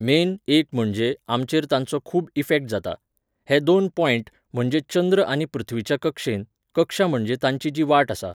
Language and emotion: Goan Konkani, neutral